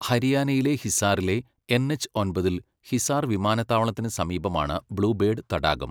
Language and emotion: Malayalam, neutral